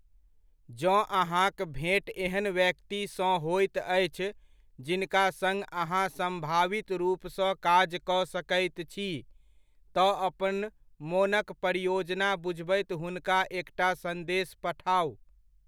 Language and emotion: Maithili, neutral